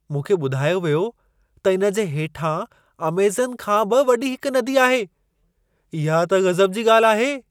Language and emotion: Sindhi, surprised